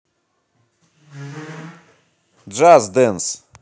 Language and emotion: Russian, positive